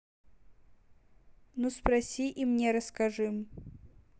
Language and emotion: Russian, neutral